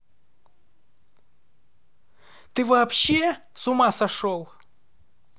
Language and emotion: Russian, angry